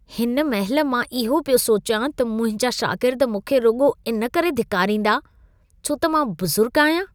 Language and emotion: Sindhi, disgusted